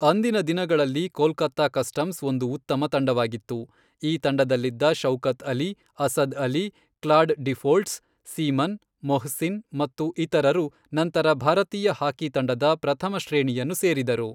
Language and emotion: Kannada, neutral